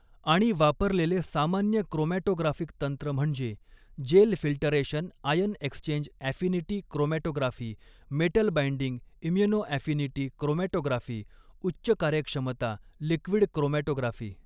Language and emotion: Marathi, neutral